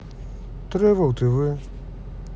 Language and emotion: Russian, neutral